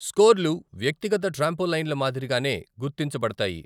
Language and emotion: Telugu, neutral